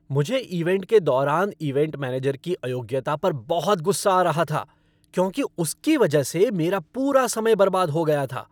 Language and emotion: Hindi, angry